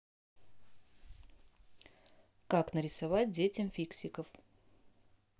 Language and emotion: Russian, neutral